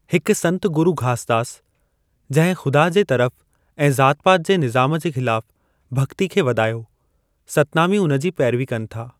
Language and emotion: Sindhi, neutral